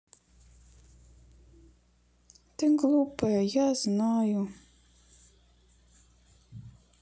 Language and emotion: Russian, sad